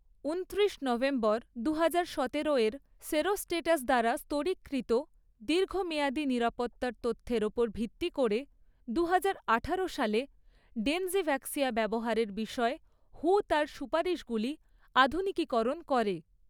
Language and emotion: Bengali, neutral